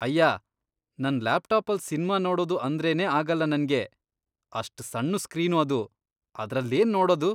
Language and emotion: Kannada, disgusted